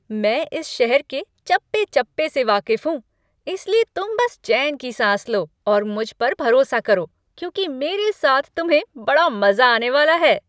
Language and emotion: Hindi, happy